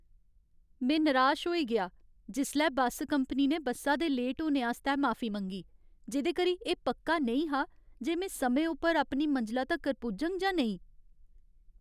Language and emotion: Dogri, sad